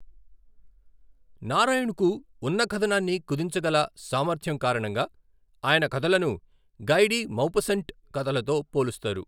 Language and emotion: Telugu, neutral